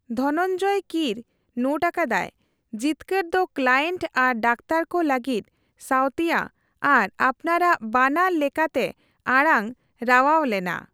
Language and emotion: Santali, neutral